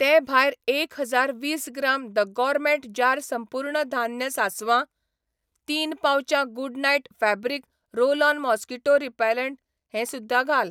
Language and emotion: Goan Konkani, neutral